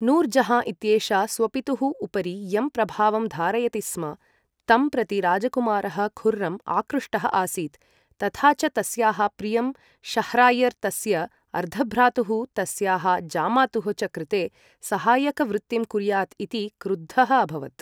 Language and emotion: Sanskrit, neutral